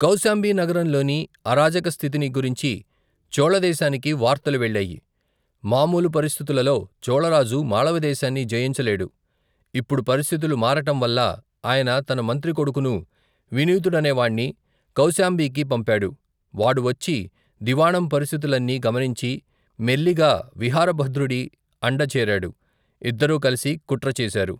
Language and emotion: Telugu, neutral